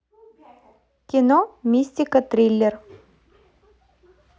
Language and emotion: Russian, positive